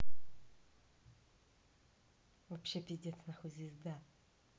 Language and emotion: Russian, angry